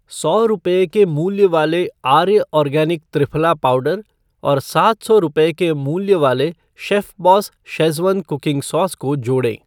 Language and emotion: Hindi, neutral